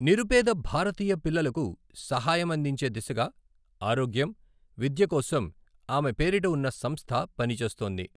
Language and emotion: Telugu, neutral